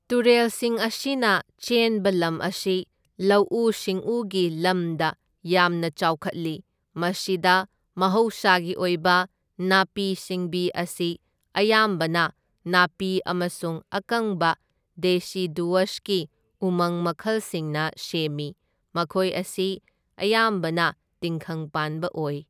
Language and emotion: Manipuri, neutral